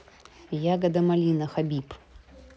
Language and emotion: Russian, neutral